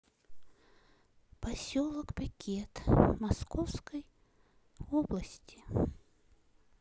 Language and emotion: Russian, sad